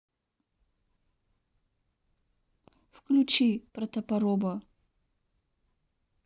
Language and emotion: Russian, neutral